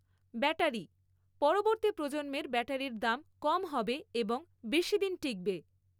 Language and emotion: Bengali, neutral